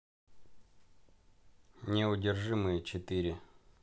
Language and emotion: Russian, neutral